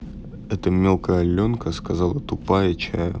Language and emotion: Russian, neutral